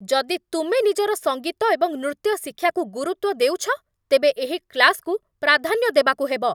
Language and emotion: Odia, angry